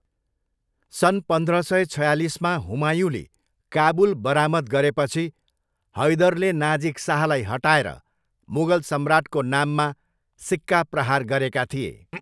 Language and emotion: Nepali, neutral